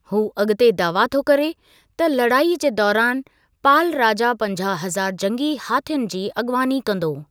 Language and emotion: Sindhi, neutral